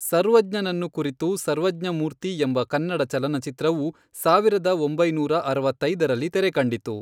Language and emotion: Kannada, neutral